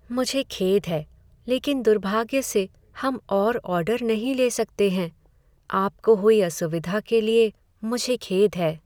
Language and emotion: Hindi, sad